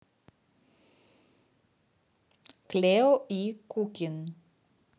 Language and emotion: Russian, neutral